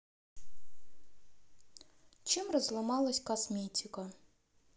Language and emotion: Russian, sad